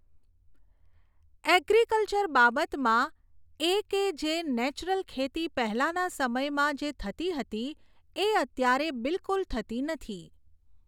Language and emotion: Gujarati, neutral